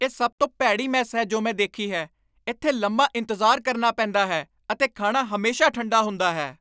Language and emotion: Punjabi, angry